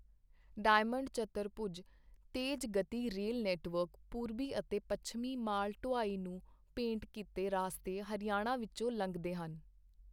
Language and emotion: Punjabi, neutral